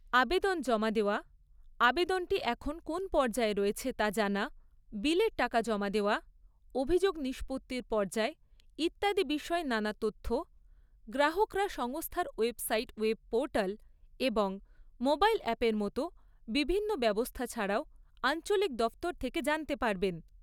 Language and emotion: Bengali, neutral